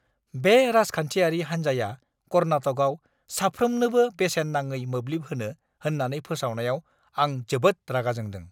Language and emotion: Bodo, angry